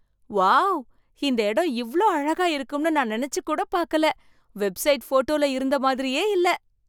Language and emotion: Tamil, surprised